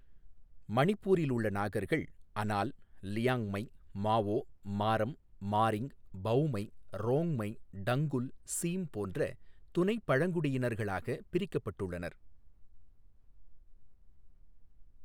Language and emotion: Tamil, neutral